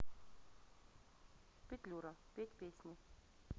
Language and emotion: Russian, neutral